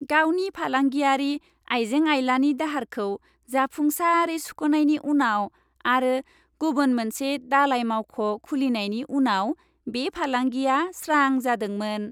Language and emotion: Bodo, happy